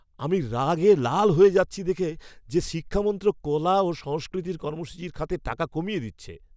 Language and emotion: Bengali, angry